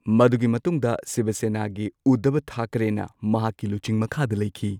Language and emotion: Manipuri, neutral